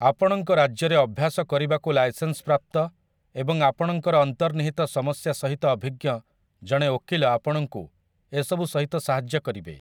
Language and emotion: Odia, neutral